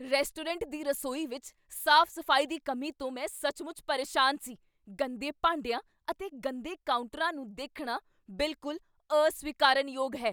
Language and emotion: Punjabi, angry